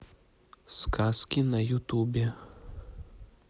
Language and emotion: Russian, neutral